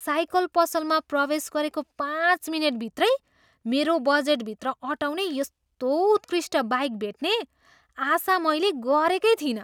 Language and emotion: Nepali, surprised